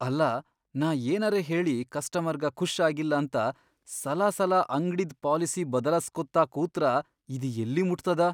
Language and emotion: Kannada, fearful